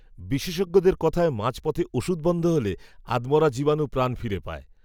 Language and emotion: Bengali, neutral